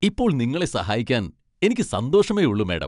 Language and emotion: Malayalam, happy